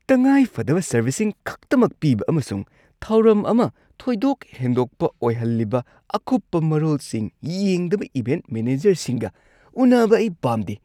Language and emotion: Manipuri, disgusted